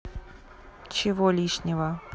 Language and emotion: Russian, neutral